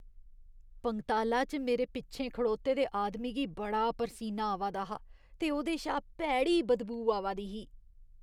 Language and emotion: Dogri, disgusted